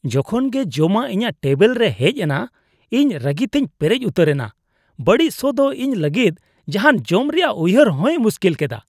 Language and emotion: Santali, disgusted